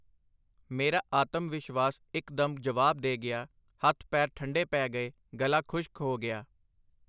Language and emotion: Punjabi, neutral